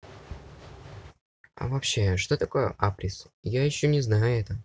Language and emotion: Russian, neutral